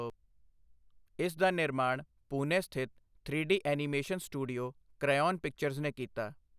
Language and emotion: Punjabi, neutral